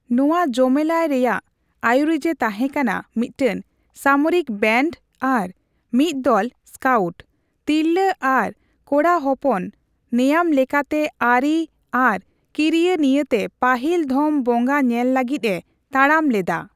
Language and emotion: Santali, neutral